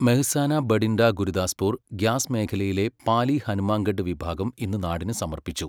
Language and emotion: Malayalam, neutral